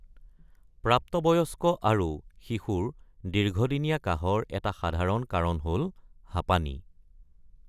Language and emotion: Assamese, neutral